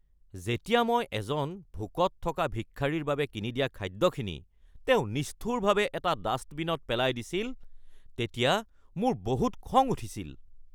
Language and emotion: Assamese, angry